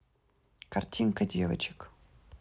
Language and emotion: Russian, neutral